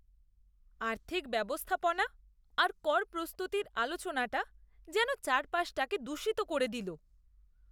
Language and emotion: Bengali, disgusted